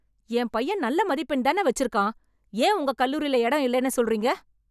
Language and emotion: Tamil, angry